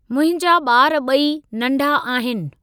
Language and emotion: Sindhi, neutral